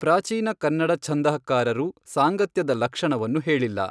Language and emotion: Kannada, neutral